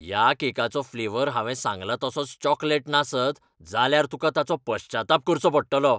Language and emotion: Goan Konkani, angry